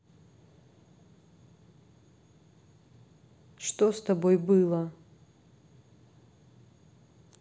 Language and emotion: Russian, neutral